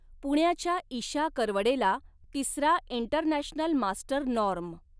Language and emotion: Marathi, neutral